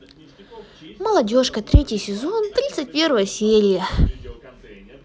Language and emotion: Russian, positive